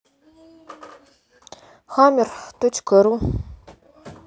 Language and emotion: Russian, sad